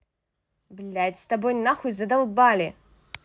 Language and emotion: Russian, angry